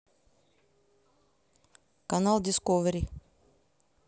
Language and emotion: Russian, neutral